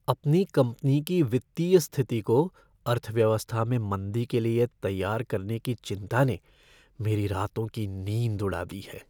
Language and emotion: Hindi, fearful